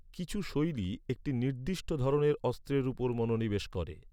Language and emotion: Bengali, neutral